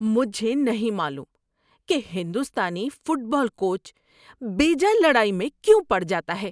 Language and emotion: Urdu, disgusted